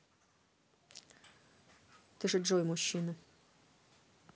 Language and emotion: Russian, neutral